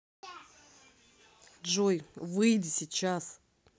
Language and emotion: Russian, angry